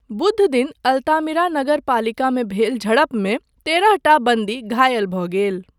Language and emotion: Maithili, neutral